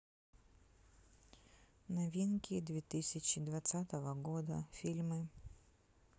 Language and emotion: Russian, neutral